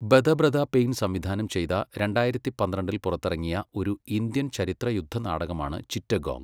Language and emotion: Malayalam, neutral